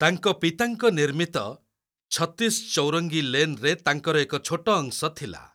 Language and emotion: Odia, neutral